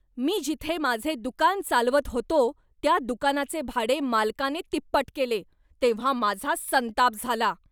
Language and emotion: Marathi, angry